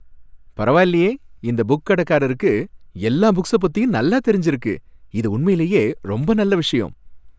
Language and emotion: Tamil, happy